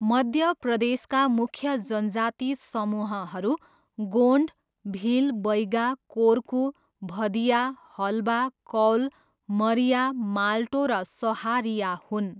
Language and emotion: Nepali, neutral